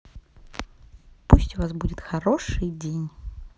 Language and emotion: Russian, positive